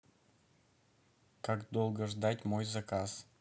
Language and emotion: Russian, neutral